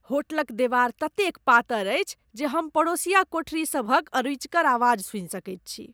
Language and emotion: Maithili, disgusted